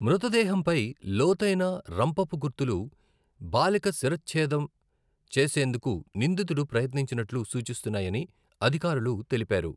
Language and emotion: Telugu, neutral